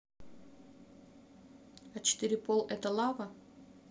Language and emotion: Russian, neutral